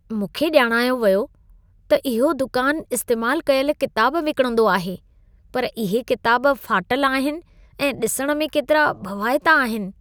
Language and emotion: Sindhi, disgusted